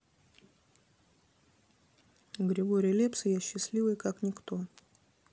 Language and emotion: Russian, neutral